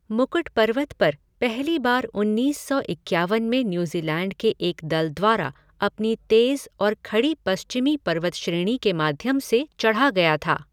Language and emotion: Hindi, neutral